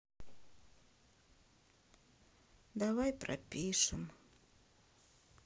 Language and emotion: Russian, sad